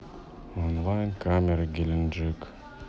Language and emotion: Russian, neutral